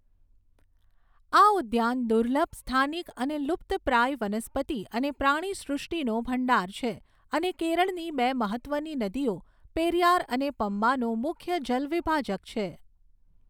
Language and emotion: Gujarati, neutral